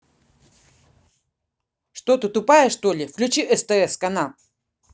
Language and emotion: Russian, angry